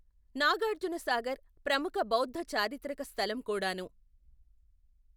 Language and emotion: Telugu, neutral